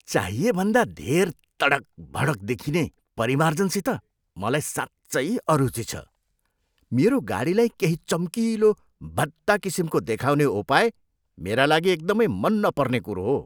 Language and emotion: Nepali, disgusted